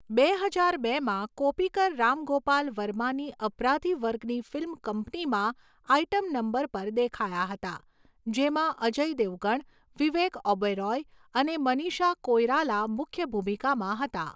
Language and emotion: Gujarati, neutral